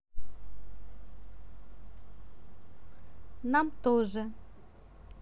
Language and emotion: Russian, neutral